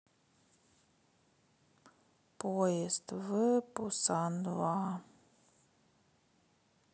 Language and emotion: Russian, sad